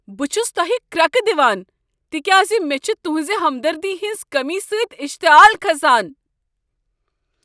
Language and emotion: Kashmiri, angry